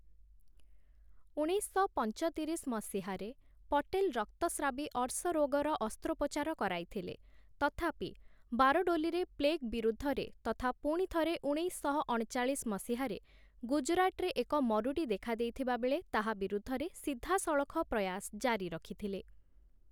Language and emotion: Odia, neutral